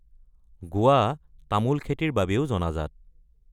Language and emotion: Assamese, neutral